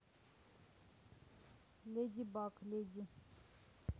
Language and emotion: Russian, neutral